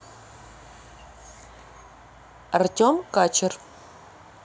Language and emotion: Russian, neutral